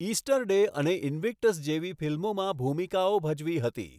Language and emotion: Gujarati, neutral